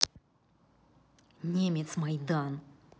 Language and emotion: Russian, angry